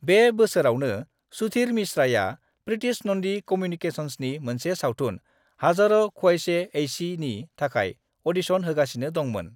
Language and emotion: Bodo, neutral